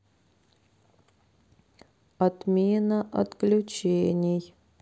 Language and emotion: Russian, sad